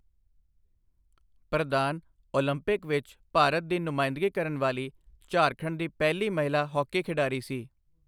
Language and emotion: Punjabi, neutral